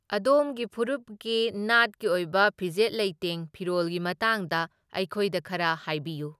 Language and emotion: Manipuri, neutral